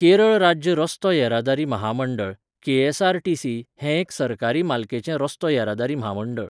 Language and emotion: Goan Konkani, neutral